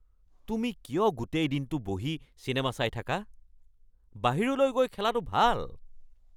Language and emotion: Assamese, angry